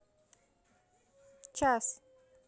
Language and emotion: Russian, neutral